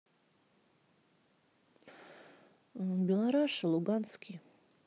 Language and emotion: Russian, neutral